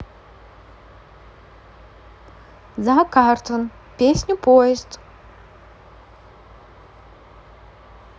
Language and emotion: Russian, neutral